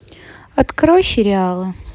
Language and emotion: Russian, neutral